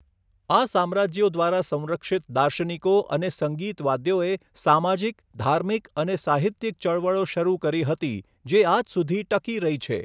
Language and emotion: Gujarati, neutral